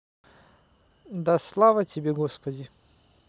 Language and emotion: Russian, neutral